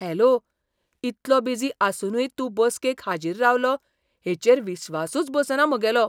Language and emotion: Goan Konkani, surprised